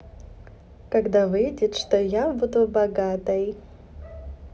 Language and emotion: Russian, positive